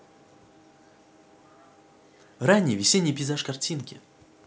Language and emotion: Russian, positive